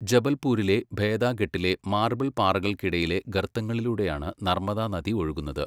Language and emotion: Malayalam, neutral